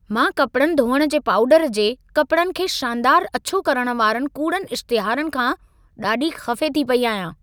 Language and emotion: Sindhi, angry